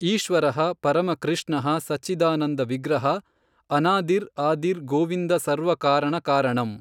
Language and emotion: Kannada, neutral